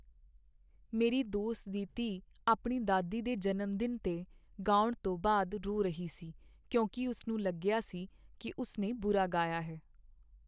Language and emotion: Punjabi, sad